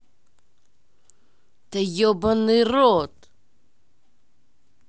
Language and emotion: Russian, angry